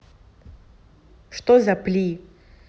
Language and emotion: Russian, angry